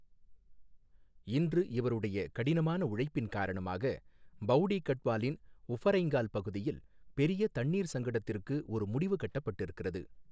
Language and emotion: Tamil, neutral